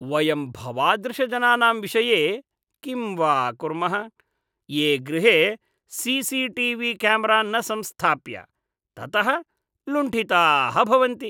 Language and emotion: Sanskrit, disgusted